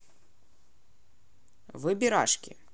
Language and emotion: Russian, neutral